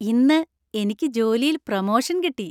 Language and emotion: Malayalam, happy